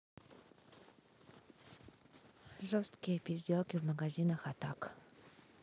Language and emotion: Russian, neutral